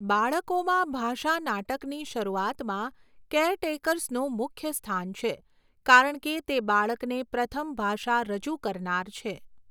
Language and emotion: Gujarati, neutral